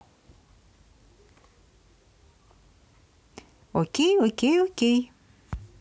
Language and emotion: Russian, positive